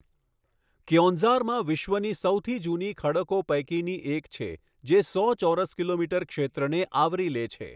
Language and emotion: Gujarati, neutral